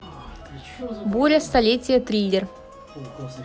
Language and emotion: Russian, neutral